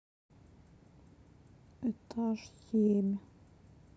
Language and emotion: Russian, sad